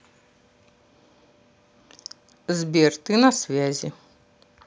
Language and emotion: Russian, neutral